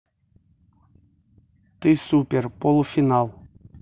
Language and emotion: Russian, neutral